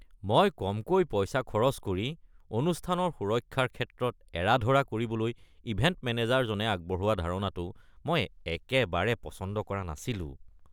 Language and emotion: Assamese, disgusted